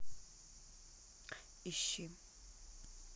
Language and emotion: Russian, neutral